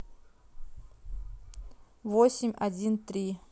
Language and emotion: Russian, neutral